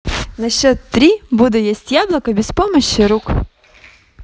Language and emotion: Russian, positive